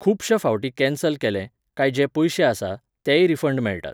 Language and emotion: Goan Konkani, neutral